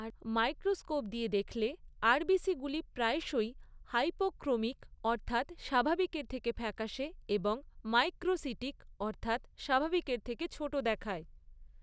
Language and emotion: Bengali, neutral